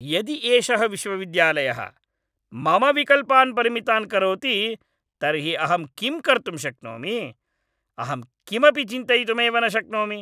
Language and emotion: Sanskrit, angry